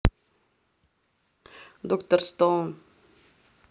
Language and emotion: Russian, neutral